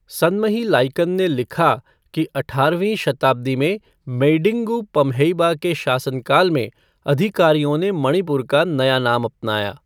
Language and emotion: Hindi, neutral